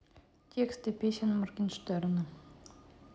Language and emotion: Russian, neutral